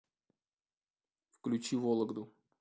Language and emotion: Russian, neutral